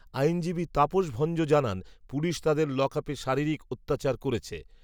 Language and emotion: Bengali, neutral